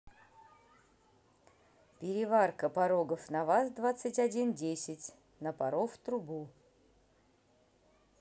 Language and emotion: Russian, neutral